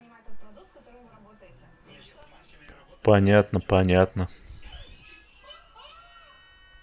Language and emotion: Russian, neutral